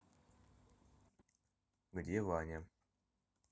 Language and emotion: Russian, neutral